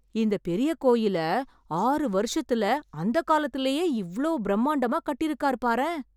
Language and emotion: Tamil, surprised